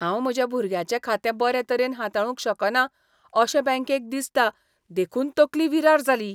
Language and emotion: Goan Konkani, disgusted